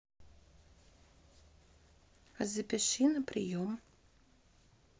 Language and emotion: Russian, neutral